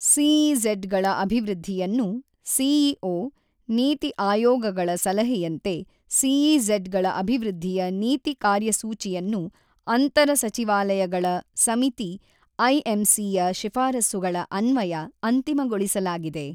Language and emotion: Kannada, neutral